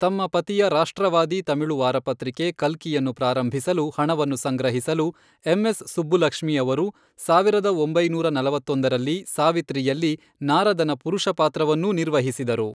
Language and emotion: Kannada, neutral